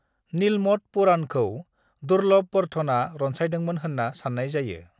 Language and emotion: Bodo, neutral